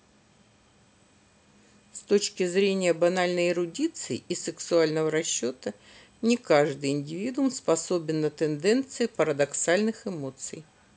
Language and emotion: Russian, neutral